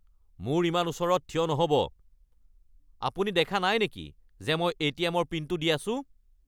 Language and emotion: Assamese, angry